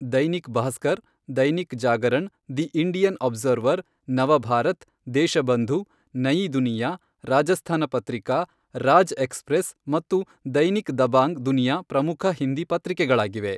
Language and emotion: Kannada, neutral